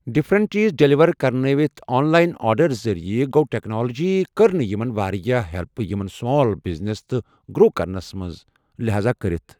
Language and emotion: Kashmiri, neutral